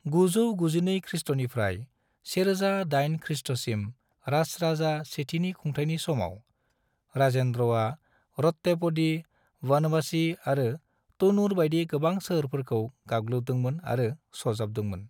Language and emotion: Bodo, neutral